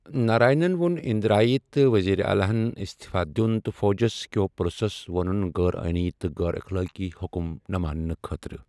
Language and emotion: Kashmiri, neutral